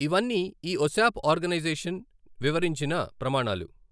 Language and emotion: Telugu, neutral